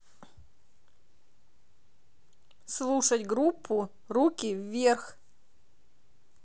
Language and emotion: Russian, neutral